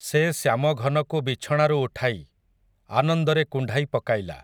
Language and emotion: Odia, neutral